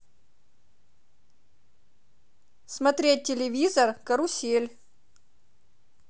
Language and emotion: Russian, positive